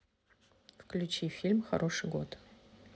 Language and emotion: Russian, neutral